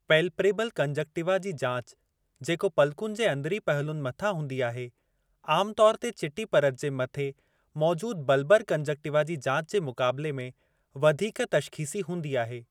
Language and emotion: Sindhi, neutral